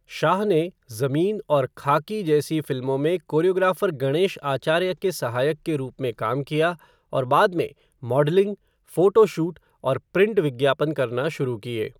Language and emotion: Hindi, neutral